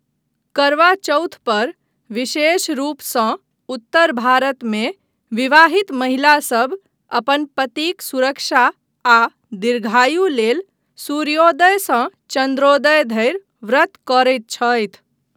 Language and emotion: Maithili, neutral